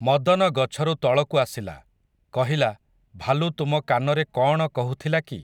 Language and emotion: Odia, neutral